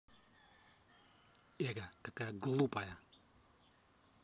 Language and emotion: Russian, angry